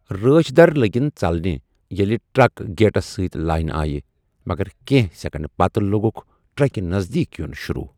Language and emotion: Kashmiri, neutral